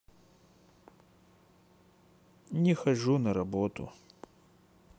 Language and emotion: Russian, sad